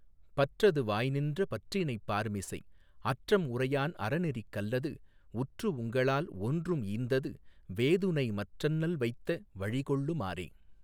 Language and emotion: Tamil, neutral